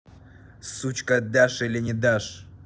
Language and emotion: Russian, angry